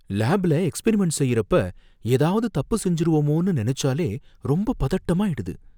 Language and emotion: Tamil, fearful